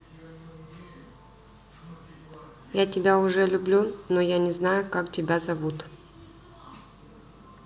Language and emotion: Russian, neutral